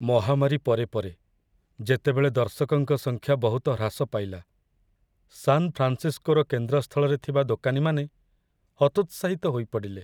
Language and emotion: Odia, sad